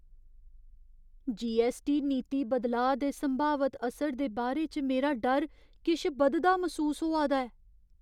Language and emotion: Dogri, fearful